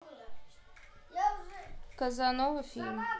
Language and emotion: Russian, neutral